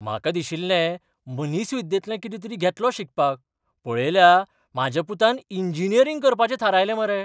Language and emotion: Goan Konkani, surprised